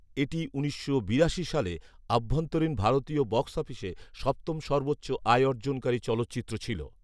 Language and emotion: Bengali, neutral